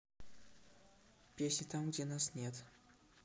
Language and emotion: Russian, neutral